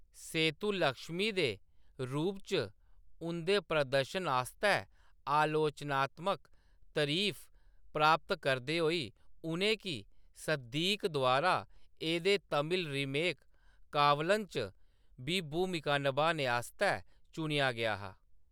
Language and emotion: Dogri, neutral